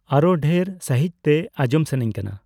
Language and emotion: Santali, neutral